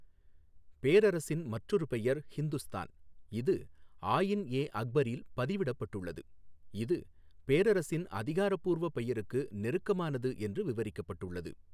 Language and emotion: Tamil, neutral